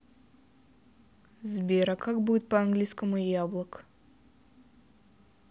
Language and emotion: Russian, neutral